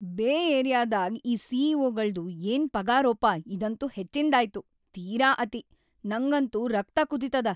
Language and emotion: Kannada, angry